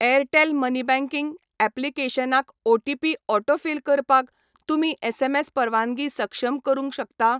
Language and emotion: Goan Konkani, neutral